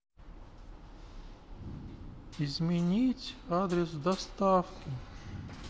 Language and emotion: Russian, sad